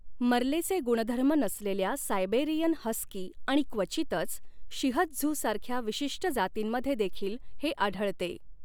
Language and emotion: Marathi, neutral